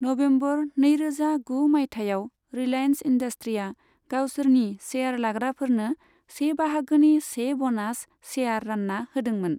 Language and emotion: Bodo, neutral